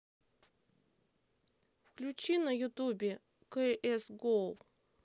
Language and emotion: Russian, neutral